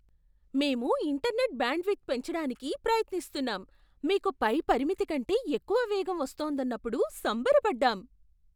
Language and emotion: Telugu, surprised